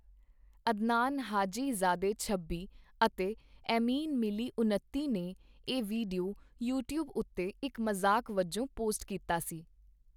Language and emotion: Punjabi, neutral